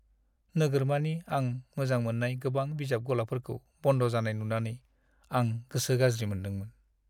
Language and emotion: Bodo, sad